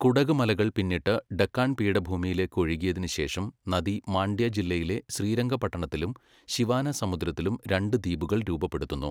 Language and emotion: Malayalam, neutral